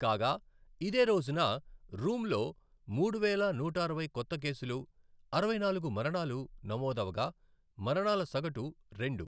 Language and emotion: Telugu, neutral